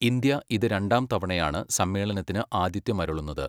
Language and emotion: Malayalam, neutral